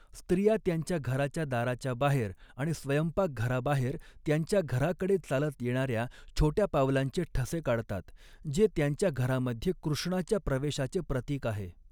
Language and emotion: Marathi, neutral